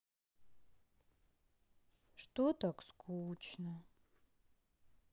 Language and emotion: Russian, sad